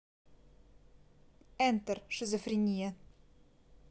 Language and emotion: Russian, neutral